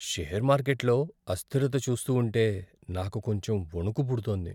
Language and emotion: Telugu, fearful